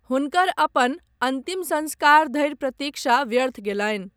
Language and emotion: Maithili, neutral